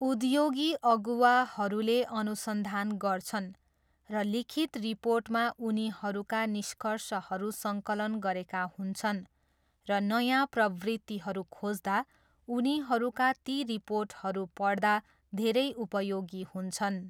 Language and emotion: Nepali, neutral